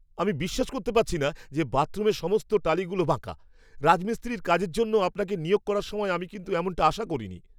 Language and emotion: Bengali, angry